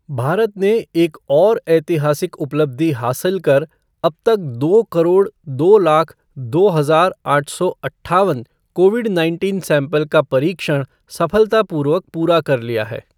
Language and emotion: Hindi, neutral